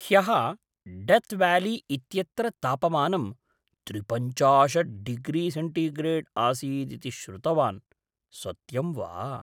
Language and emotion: Sanskrit, surprised